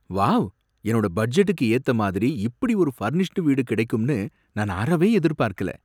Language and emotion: Tamil, surprised